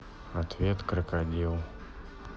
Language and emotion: Russian, neutral